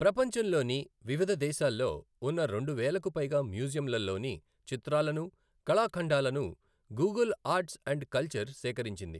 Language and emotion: Telugu, neutral